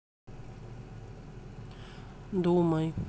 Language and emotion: Russian, neutral